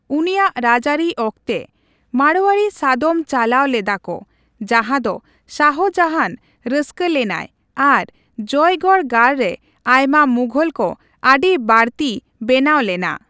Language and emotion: Santali, neutral